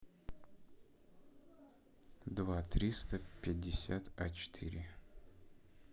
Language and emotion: Russian, neutral